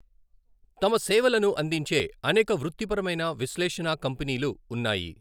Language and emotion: Telugu, neutral